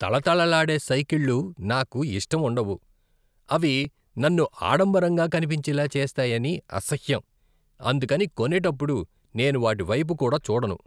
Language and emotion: Telugu, disgusted